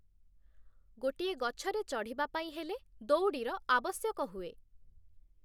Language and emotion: Odia, neutral